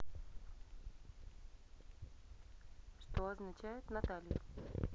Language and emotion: Russian, neutral